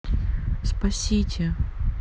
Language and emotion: Russian, sad